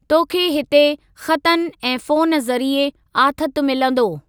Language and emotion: Sindhi, neutral